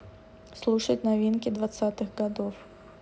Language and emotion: Russian, neutral